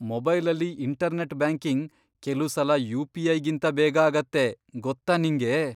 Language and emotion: Kannada, surprised